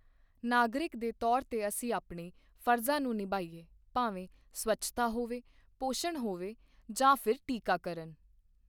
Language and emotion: Punjabi, neutral